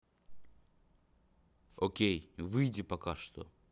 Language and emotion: Russian, neutral